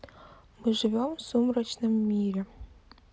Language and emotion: Russian, neutral